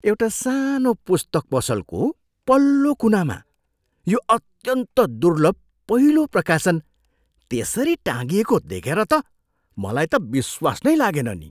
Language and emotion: Nepali, surprised